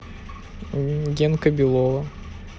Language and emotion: Russian, neutral